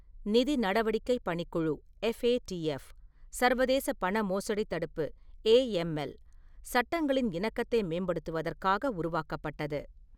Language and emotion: Tamil, neutral